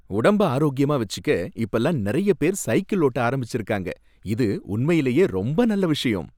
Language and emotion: Tamil, happy